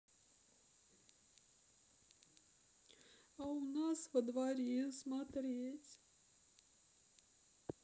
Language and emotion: Russian, sad